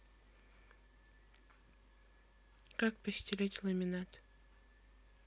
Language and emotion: Russian, neutral